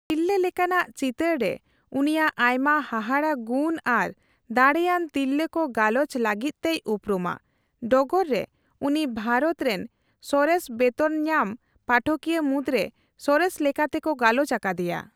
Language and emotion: Santali, neutral